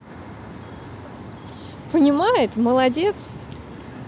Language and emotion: Russian, positive